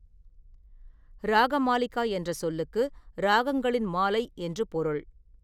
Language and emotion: Tamil, neutral